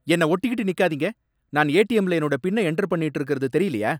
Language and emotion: Tamil, angry